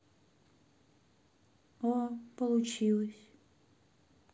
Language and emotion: Russian, sad